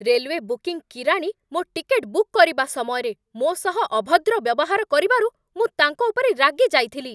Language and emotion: Odia, angry